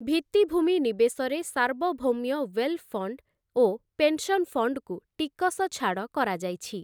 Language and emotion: Odia, neutral